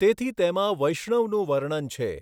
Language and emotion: Gujarati, neutral